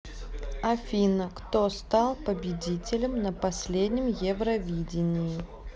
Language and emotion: Russian, neutral